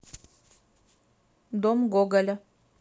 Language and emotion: Russian, neutral